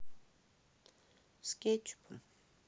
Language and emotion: Russian, neutral